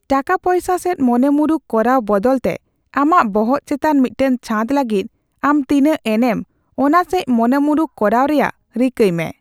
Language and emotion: Santali, neutral